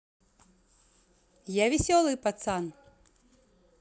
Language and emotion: Russian, positive